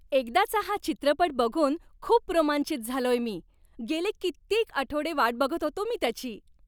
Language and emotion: Marathi, happy